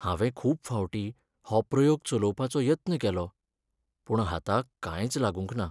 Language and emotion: Goan Konkani, sad